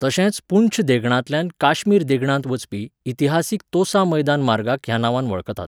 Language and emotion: Goan Konkani, neutral